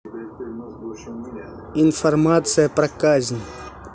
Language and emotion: Russian, neutral